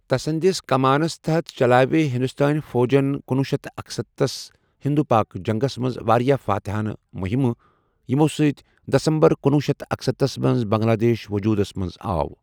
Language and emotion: Kashmiri, neutral